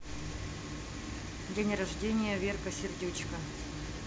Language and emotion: Russian, neutral